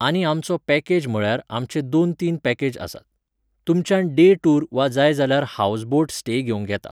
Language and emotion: Goan Konkani, neutral